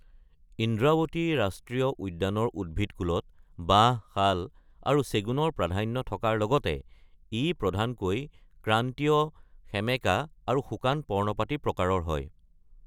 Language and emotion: Assamese, neutral